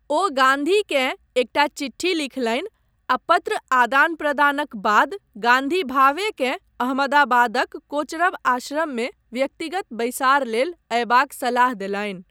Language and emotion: Maithili, neutral